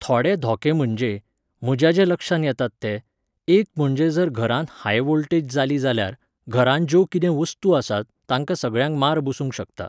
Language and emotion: Goan Konkani, neutral